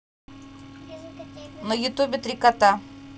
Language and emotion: Russian, neutral